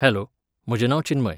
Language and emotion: Goan Konkani, neutral